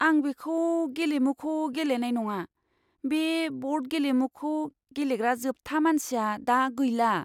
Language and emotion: Bodo, fearful